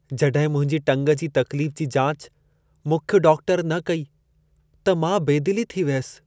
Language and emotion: Sindhi, sad